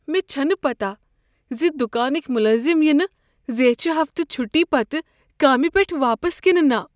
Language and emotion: Kashmiri, fearful